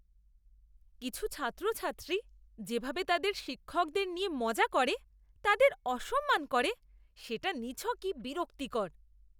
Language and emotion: Bengali, disgusted